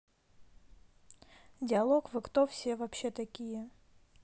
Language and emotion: Russian, neutral